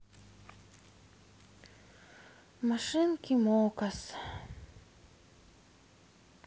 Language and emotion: Russian, sad